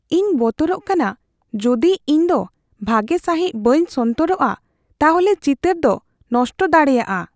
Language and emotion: Santali, fearful